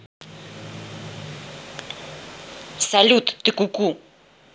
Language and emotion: Russian, angry